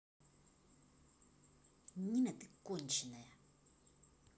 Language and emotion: Russian, angry